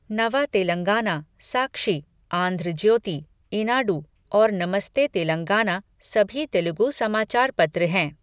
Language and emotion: Hindi, neutral